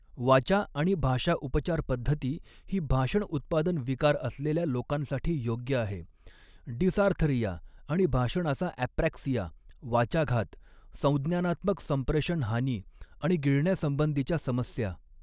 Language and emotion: Marathi, neutral